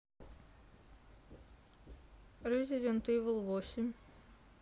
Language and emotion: Russian, neutral